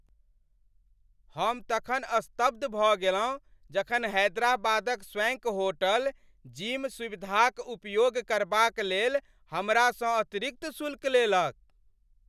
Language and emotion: Maithili, angry